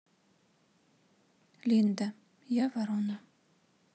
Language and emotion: Russian, neutral